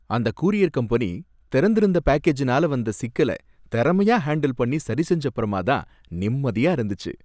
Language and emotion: Tamil, happy